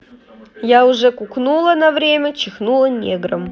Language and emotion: Russian, neutral